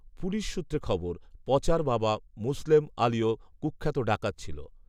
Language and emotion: Bengali, neutral